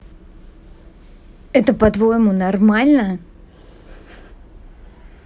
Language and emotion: Russian, angry